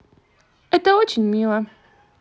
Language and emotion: Russian, positive